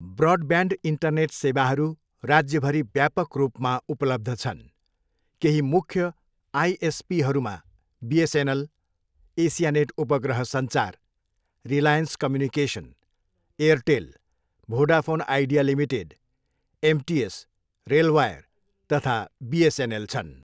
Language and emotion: Nepali, neutral